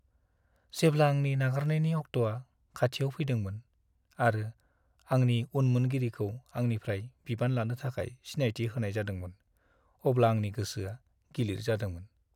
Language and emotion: Bodo, sad